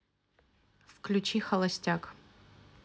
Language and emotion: Russian, neutral